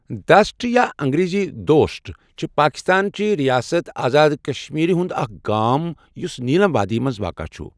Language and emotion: Kashmiri, neutral